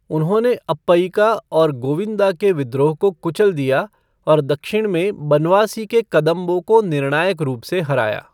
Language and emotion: Hindi, neutral